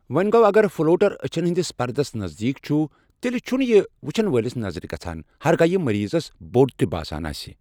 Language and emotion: Kashmiri, neutral